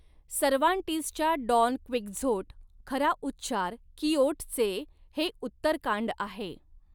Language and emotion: Marathi, neutral